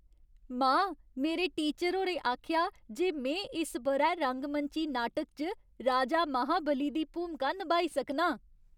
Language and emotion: Dogri, happy